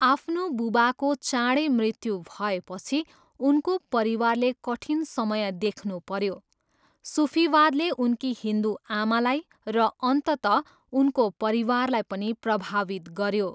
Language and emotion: Nepali, neutral